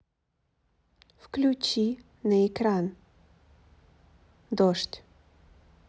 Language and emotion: Russian, neutral